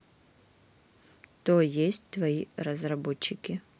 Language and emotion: Russian, neutral